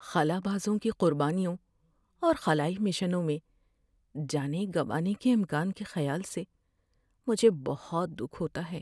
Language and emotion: Urdu, sad